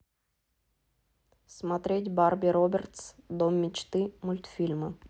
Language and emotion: Russian, neutral